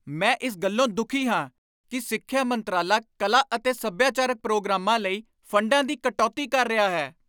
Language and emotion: Punjabi, angry